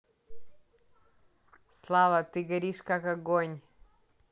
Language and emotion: Russian, neutral